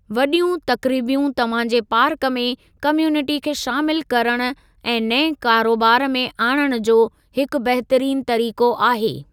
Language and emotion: Sindhi, neutral